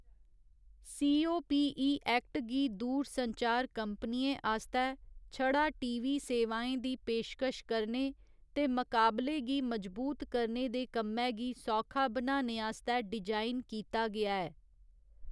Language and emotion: Dogri, neutral